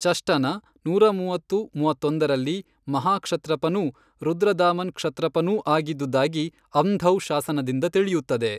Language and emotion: Kannada, neutral